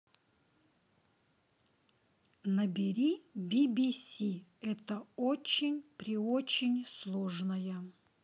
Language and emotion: Russian, neutral